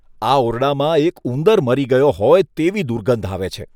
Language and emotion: Gujarati, disgusted